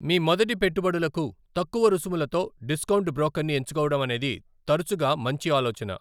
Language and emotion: Telugu, neutral